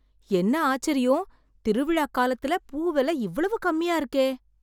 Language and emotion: Tamil, surprised